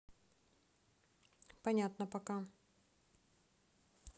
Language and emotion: Russian, neutral